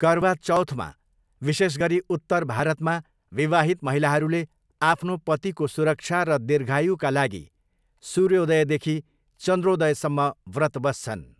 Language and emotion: Nepali, neutral